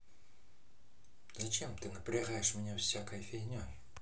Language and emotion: Russian, angry